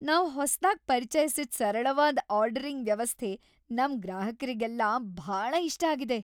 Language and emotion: Kannada, happy